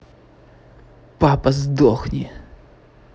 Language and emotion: Russian, angry